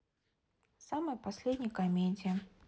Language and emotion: Russian, neutral